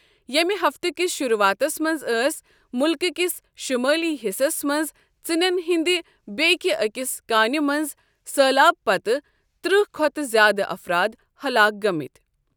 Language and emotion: Kashmiri, neutral